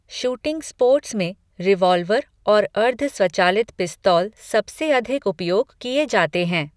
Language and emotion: Hindi, neutral